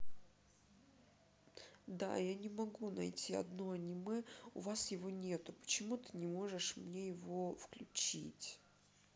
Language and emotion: Russian, sad